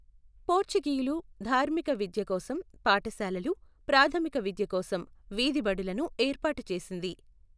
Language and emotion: Telugu, neutral